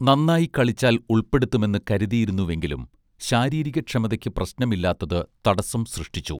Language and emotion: Malayalam, neutral